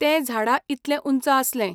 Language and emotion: Goan Konkani, neutral